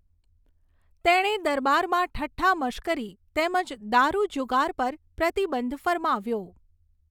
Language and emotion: Gujarati, neutral